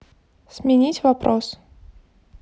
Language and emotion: Russian, neutral